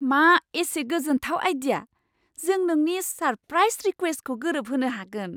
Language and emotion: Bodo, surprised